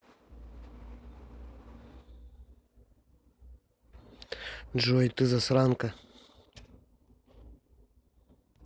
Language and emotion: Russian, neutral